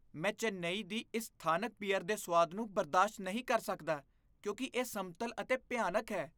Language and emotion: Punjabi, disgusted